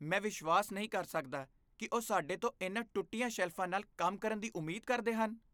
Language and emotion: Punjabi, disgusted